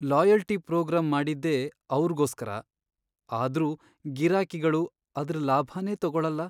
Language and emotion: Kannada, sad